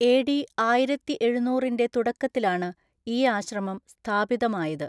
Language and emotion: Malayalam, neutral